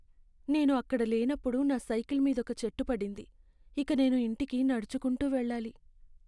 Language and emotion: Telugu, sad